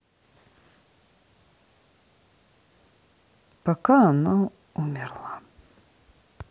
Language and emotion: Russian, sad